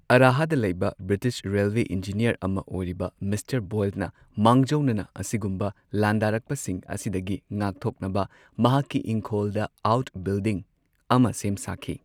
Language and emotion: Manipuri, neutral